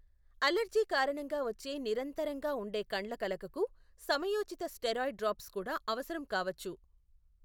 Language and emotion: Telugu, neutral